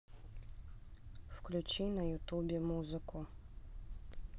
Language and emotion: Russian, neutral